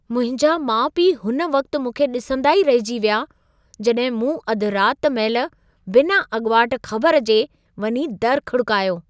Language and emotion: Sindhi, surprised